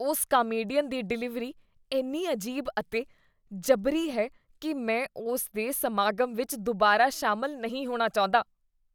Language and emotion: Punjabi, disgusted